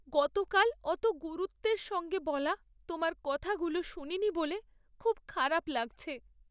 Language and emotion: Bengali, sad